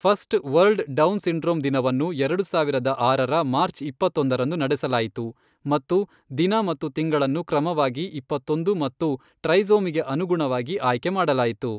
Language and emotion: Kannada, neutral